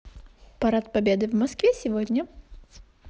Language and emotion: Russian, positive